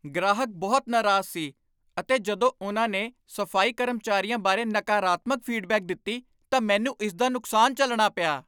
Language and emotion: Punjabi, angry